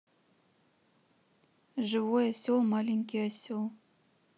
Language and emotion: Russian, neutral